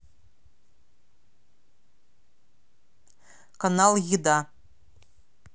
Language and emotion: Russian, neutral